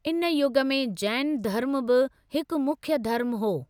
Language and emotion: Sindhi, neutral